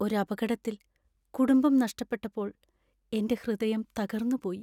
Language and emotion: Malayalam, sad